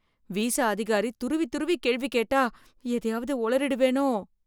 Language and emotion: Tamil, fearful